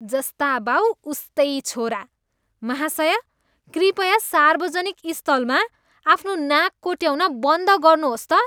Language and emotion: Nepali, disgusted